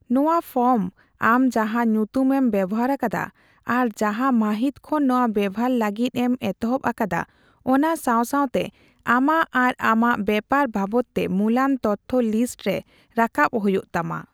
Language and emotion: Santali, neutral